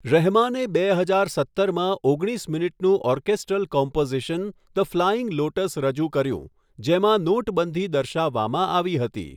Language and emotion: Gujarati, neutral